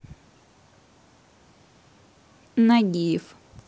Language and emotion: Russian, neutral